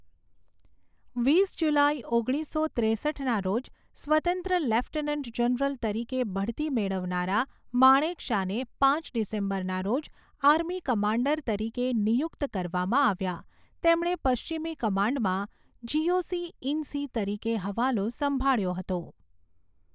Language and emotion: Gujarati, neutral